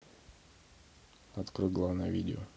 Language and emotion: Russian, neutral